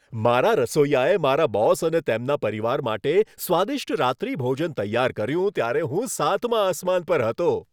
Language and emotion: Gujarati, happy